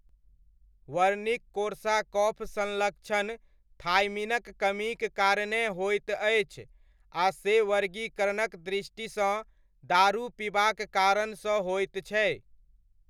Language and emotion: Maithili, neutral